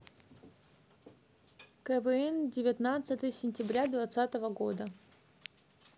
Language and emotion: Russian, neutral